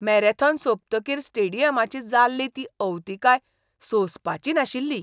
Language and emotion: Goan Konkani, disgusted